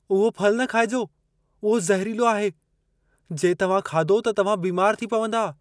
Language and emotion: Sindhi, fearful